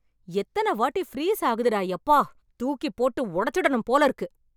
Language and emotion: Tamil, angry